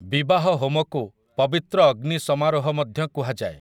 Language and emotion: Odia, neutral